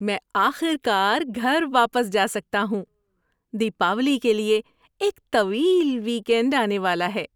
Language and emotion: Urdu, happy